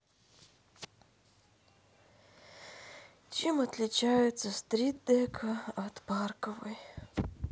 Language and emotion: Russian, sad